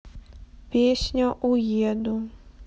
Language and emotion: Russian, sad